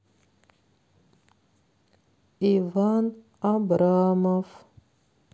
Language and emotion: Russian, neutral